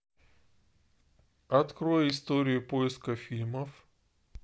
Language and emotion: Russian, neutral